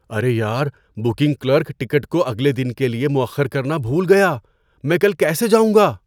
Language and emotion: Urdu, surprised